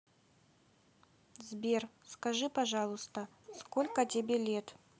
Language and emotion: Russian, neutral